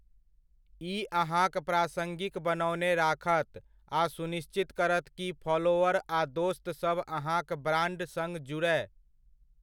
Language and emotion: Maithili, neutral